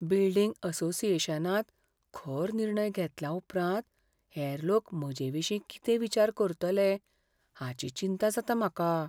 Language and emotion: Goan Konkani, fearful